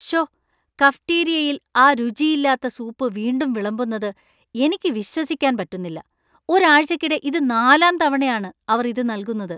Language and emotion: Malayalam, disgusted